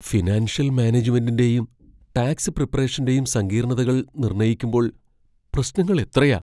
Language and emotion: Malayalam, fearful